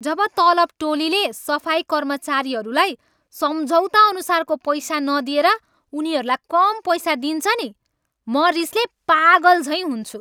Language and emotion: Nepali, angry